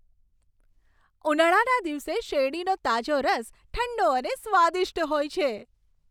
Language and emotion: Gujarati, happy